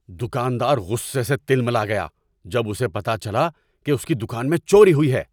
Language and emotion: Urdu, angry